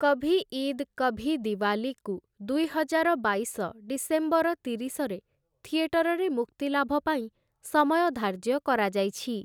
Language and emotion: Odia, neutral